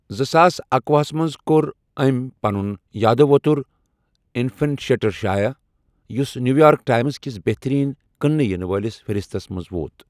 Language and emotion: Kashmiri, neutral